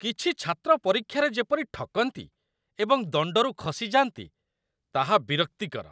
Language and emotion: Odia, disgusted